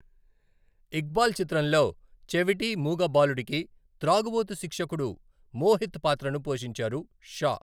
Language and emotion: Telugu, neutral